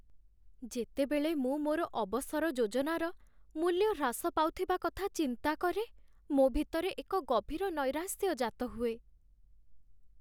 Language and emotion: Odia, sad